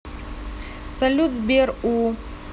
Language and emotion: Russian, neutral